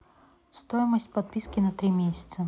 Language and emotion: Russian, neutral